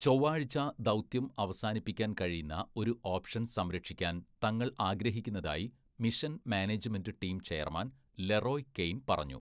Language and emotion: Malayalam, neutral